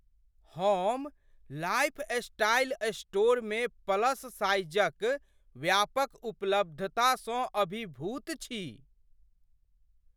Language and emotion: Maithili, surprised